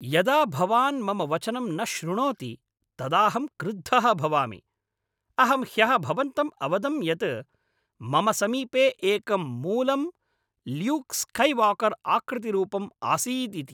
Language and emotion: Sanskrit, angry